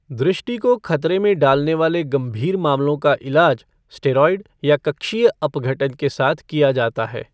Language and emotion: Hindi, neutral